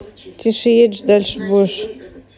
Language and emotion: Russian, neutral